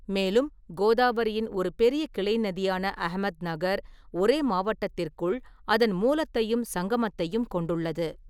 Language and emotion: Tamil, neutral